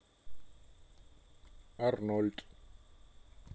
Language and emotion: Russian, neutral